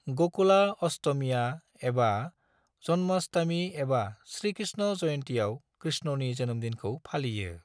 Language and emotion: Bodo, neutral